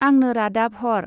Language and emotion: Bodo, neutral